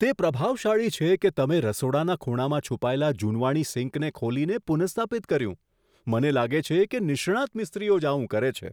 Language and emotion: Gujarati, surprised